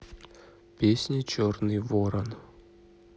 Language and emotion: Russian, neutral